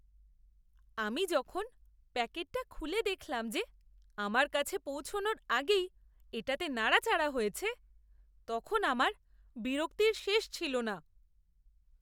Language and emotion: Bengali, disgusted